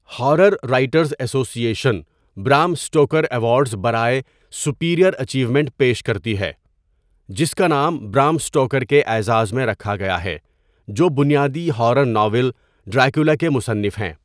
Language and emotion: Urdu, neutral